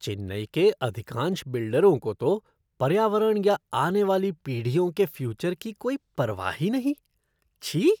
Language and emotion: Hindi, disgusted